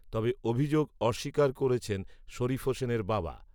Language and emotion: Bengali, neutral